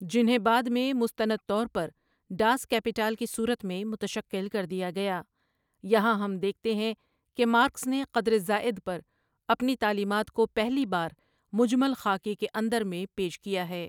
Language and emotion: Urdu, neutral